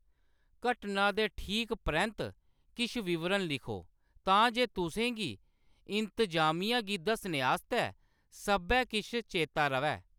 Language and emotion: Dogri, neutral